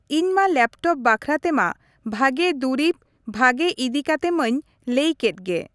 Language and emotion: Santali, neutral